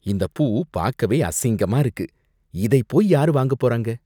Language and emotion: Tamil, disgusted